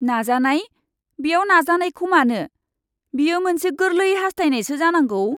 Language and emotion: Bodo, disgusted